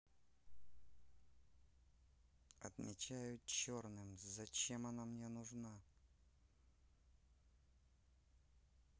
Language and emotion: Russian, neutral